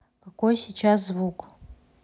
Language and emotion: Russian, neutral